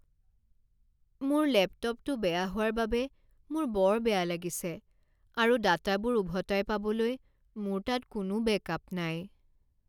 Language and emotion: Assamese, sad